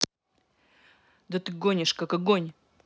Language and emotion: Russian, angry